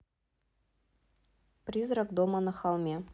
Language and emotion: Russian, neutral